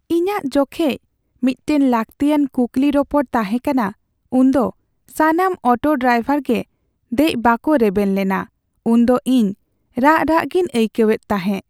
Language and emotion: Santali, sad